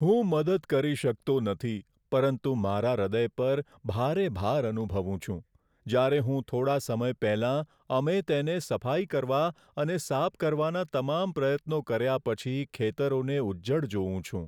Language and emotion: Gujarati, sad